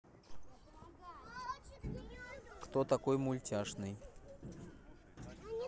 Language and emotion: Russian, neutral